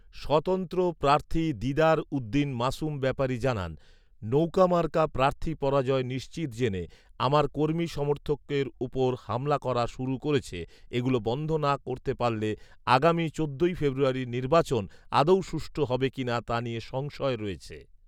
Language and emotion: Bengali, neutral